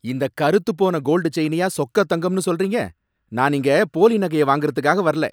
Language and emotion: Tamil, angry